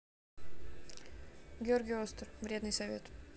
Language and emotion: Russian, neutral